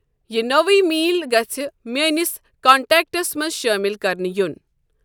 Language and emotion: Kashmiri, neutral